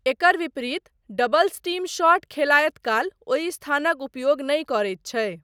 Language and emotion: Maithili, neutral